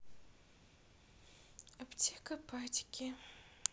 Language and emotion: Russian, sad